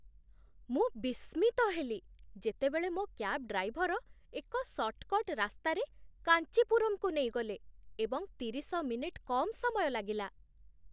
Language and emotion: Odia, surprised